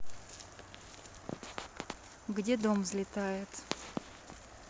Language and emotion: Russian, neutral